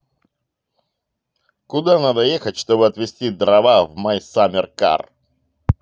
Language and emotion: Russian, positive